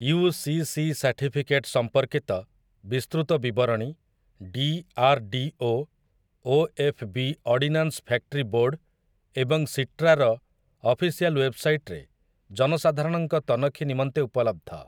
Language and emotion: Odia, neutral